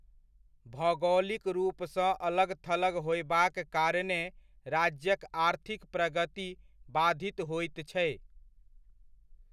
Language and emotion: Maithili, neutral